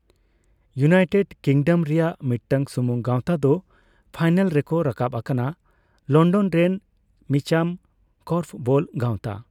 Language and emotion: Santali, neutral